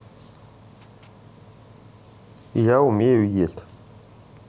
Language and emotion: Russian, neutral